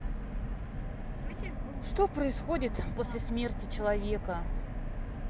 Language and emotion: Russian, sad